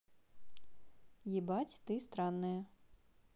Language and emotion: Russian, neutral